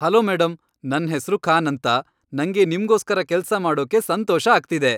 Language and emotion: Kannada, happy